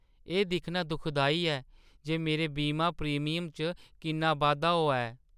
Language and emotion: Dogri, sad